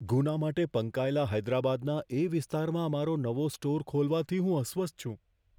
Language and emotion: Gujarati, fearful